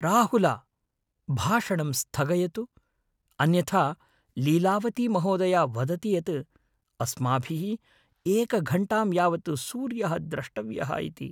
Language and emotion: Sanskrit, fearful